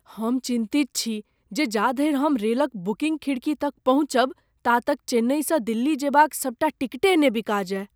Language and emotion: Maithili, fearful